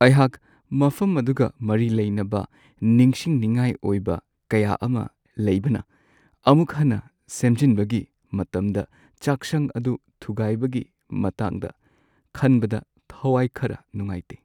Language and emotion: Manipuri, sad